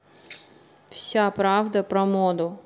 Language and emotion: Russian, neutral